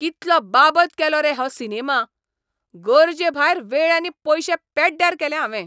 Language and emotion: Goan Konkani, angry